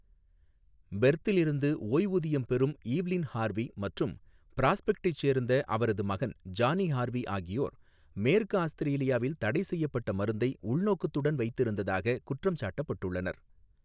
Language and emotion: Tamil, neutral